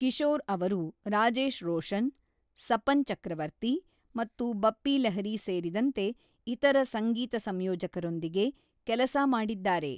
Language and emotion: Kannada, neutral